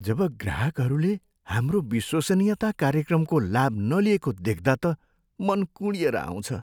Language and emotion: Nepali, sad